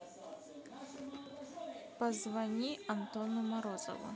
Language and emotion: Russian, neutral